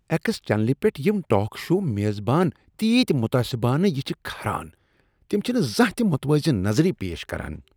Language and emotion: Kashmiri, disgusted